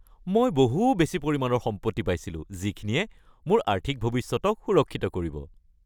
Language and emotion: Assamese, happy